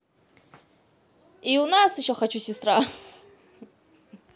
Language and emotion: Russian, positive